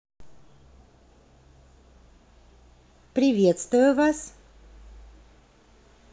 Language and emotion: Russian, positive